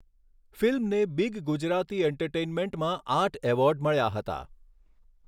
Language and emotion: Gujarati, neutral